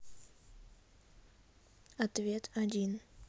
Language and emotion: Russian, neutral